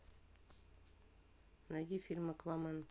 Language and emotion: Russian, neutral